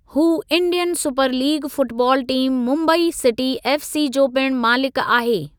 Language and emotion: Sindhi, neutral